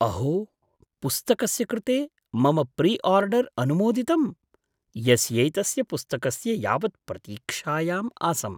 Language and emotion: Sanskrit, surprised